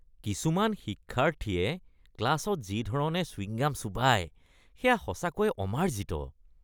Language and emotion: Assamese, disgusted